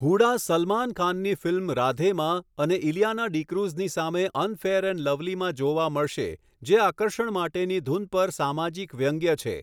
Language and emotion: Gujarati, neutral